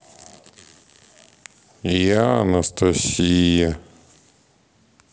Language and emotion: Russian, sad